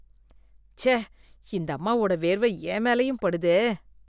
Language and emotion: Tamil, disgusted